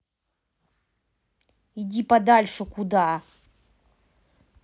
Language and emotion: Russian, angry